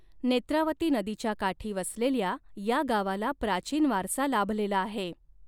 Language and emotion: Marathi, neutral